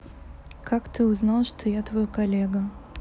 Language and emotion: Russian, sad